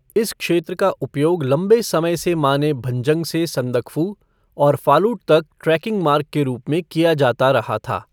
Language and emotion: Hindi, neutral